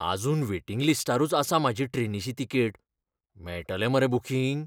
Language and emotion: Goan Konkani, fearful